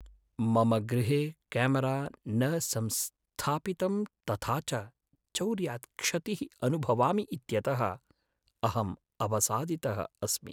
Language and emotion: Sanskrit, sad